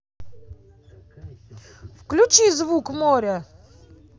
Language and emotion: Russian, angry